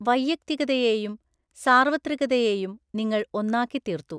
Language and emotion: Malayalam, neutral